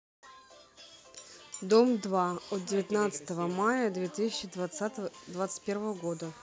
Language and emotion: Russian, neutral